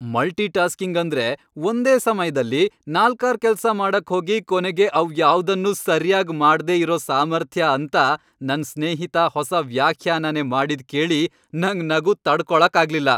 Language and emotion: Kannada, happy